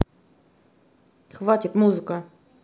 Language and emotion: Russian, angry